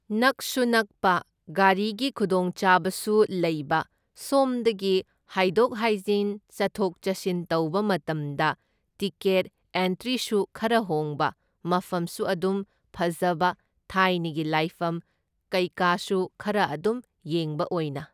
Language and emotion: Manipuri, neutral